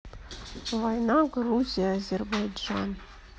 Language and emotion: Russian, neutral